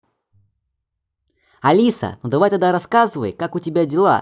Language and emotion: Russian, positive